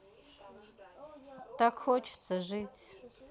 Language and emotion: Russian, sad